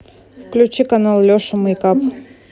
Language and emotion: Russian, neutral